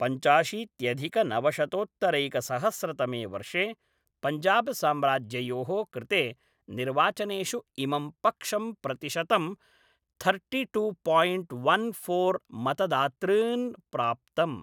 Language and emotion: Sanskrit, neutral